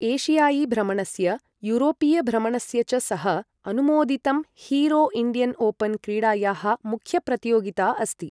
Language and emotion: Sanskrit, neutral